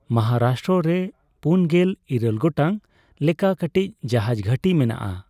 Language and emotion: Santali, neutral